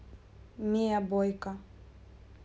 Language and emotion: Russian, neutral